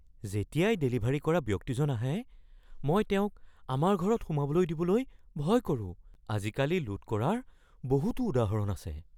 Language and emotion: Assamese, fearful